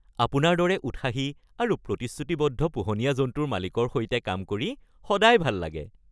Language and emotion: Assamese, happy